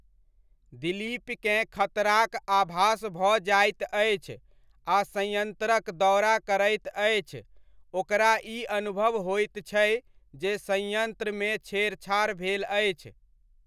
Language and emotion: Maithili, neutral